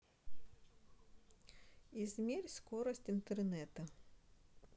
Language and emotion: Russian, neutral